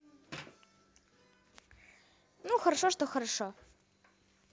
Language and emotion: Russian, positive